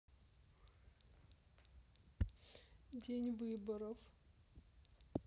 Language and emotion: Russian, sad